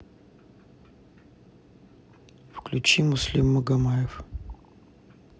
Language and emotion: Russian, neutral